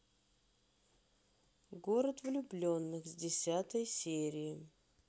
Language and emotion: Russian, neutral